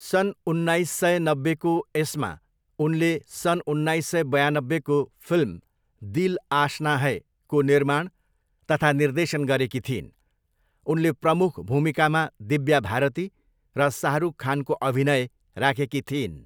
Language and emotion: Nepali, neutral